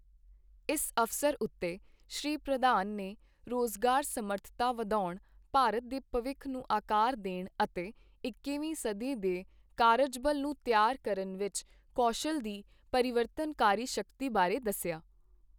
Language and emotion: Punjabi, neutral